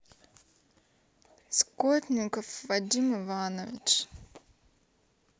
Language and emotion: Russian, sad